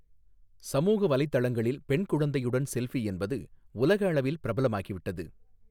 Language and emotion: Tamil, neutral